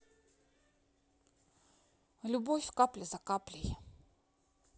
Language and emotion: Russian, neutral